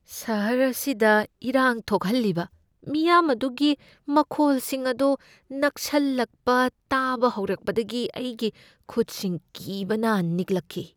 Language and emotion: Manipuri, fearful